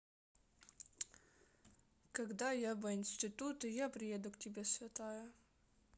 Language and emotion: Russian, neutral